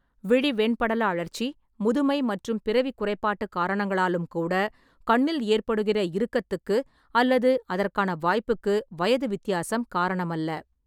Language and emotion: Tamil, neutral